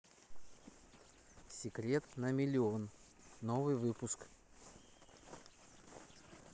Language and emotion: Russian, neutral